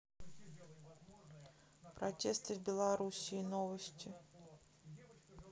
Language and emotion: Russian, neutral